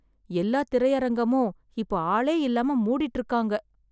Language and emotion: Tamil, sad